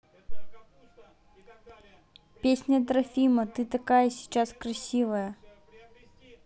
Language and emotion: Russian, neutral